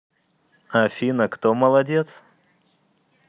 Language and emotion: Russian, positive